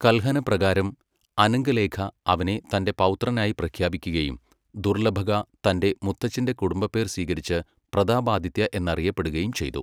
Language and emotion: Malayalam, neutral